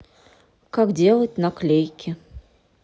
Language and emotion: Russian, neutral